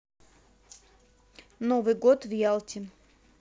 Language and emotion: Russian, neutral